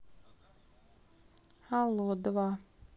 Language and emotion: Russian, neutral